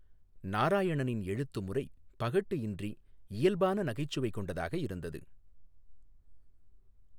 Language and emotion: Tamil, neutral